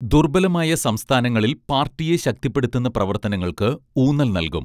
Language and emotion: Malayalam, neutral